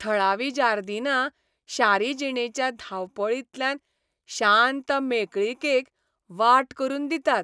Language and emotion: Goan Konkani, happy